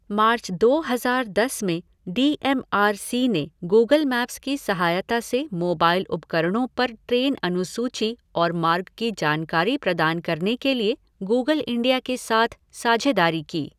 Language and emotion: Hindi, neutral